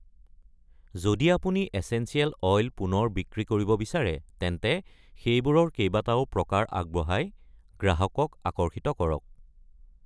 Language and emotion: Assamese, neutral